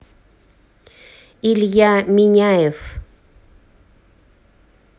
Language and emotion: Russian, neutral